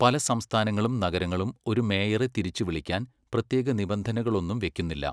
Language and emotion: Malayalam, neutral